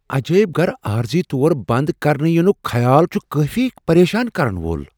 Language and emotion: Kashmiri, fearful